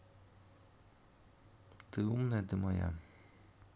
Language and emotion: Russian, neutral